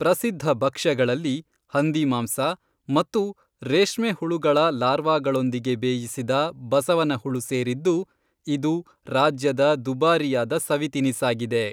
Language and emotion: Kannada, neutral